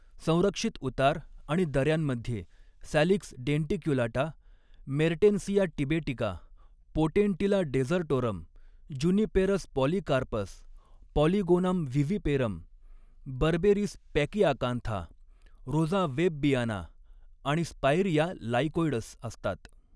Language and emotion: Marathi, neutral